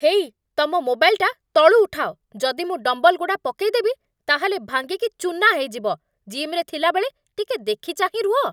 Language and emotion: Odia, angry